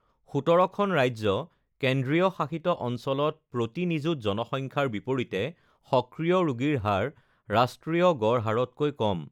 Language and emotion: Assamese, neutral